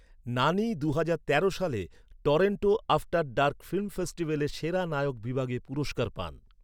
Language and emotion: Bengali, neutral